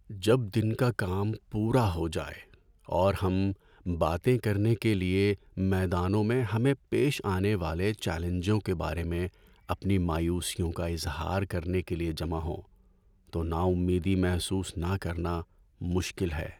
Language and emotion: Urdu, sad